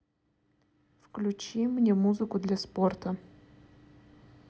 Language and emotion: Russian, neutral